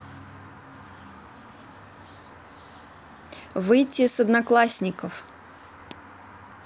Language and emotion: Russian, neutral